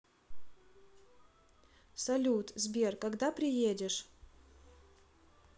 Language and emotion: Russian, neutral